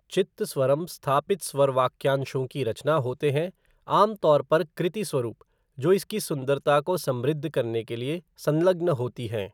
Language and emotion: Hindi, neutral